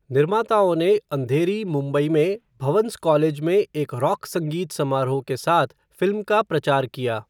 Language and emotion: Hindi, neutral